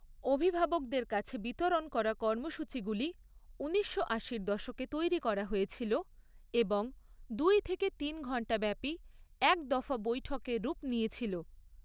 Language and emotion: Bengali, neutral